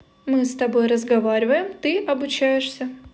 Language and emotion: Russian, positive